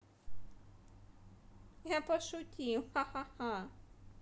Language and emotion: Russian, positive